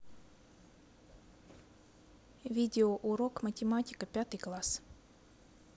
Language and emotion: Russian, neutral